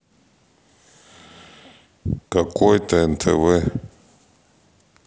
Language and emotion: Russian, neutral